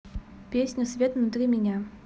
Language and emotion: Russian, neutral